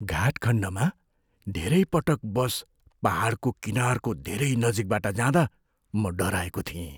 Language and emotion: Nepali, fearful